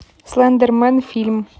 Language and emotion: Russian, neutral